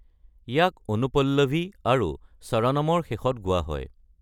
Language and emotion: Assamese, neutral